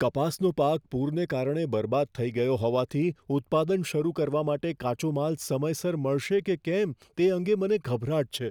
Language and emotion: Gujarati, fearful